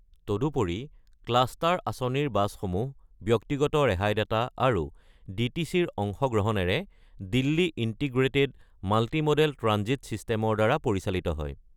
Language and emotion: Assamese, neutral